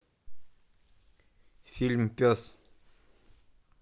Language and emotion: Russian, neutral